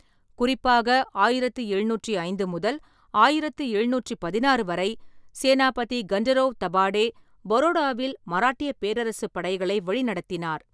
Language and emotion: Tamil, neutral